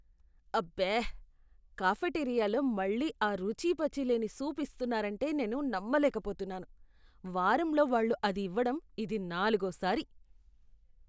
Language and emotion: Telugu, disgusted